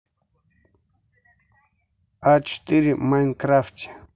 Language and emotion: Russian, neutral